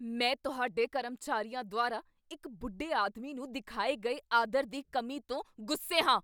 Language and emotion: Punjabi, angry